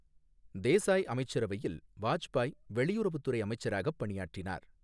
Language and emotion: Tamil, neutral